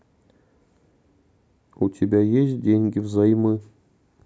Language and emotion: Russian, neutral